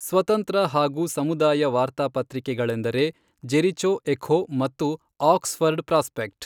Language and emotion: Kannada, neutral